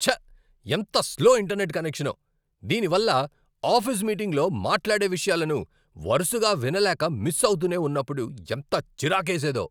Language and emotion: Telugu, angry